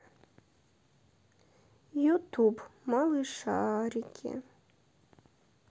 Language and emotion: Russian, sad